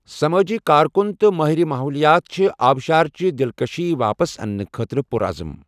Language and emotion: Kashmiri, neutral